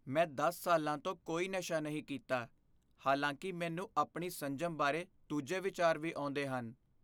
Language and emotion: Punjabi, fearful